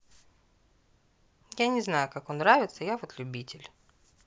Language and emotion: Russian, neutral